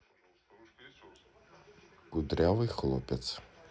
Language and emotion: Russian, neutral